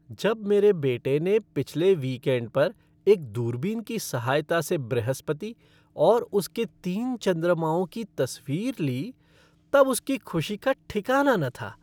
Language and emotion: Hindi, happy